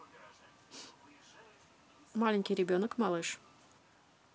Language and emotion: Russian, neutral